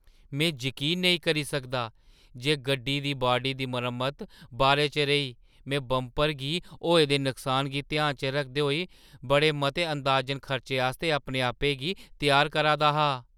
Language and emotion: Dogri, surprised